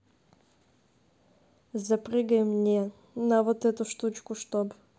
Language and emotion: Russian, neutral